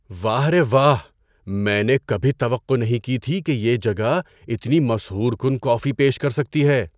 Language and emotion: Urdu, surprised